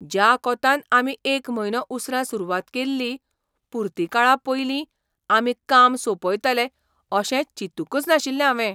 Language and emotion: Goan Konkani, surprised